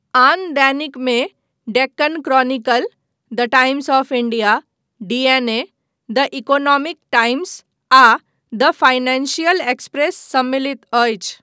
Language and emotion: Maithili, neutral